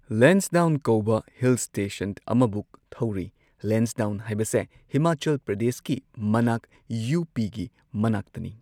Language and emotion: Manipuri, neutral